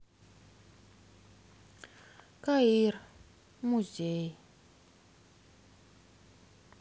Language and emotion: Russian, sad